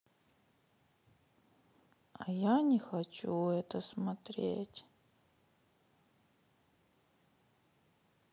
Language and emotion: Russian, sad